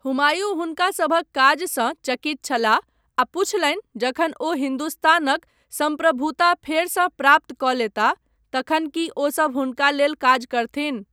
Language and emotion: Maithili, neutral